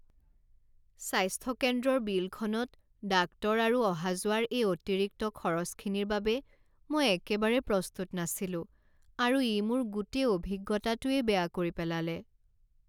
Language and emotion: Assamese, sad